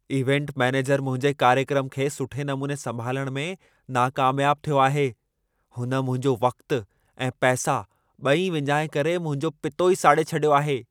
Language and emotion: Sindhi, angry